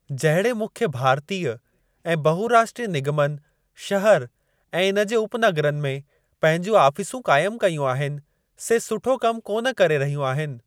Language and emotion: Sindhi, neutral